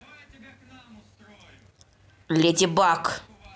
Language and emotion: Russian, angry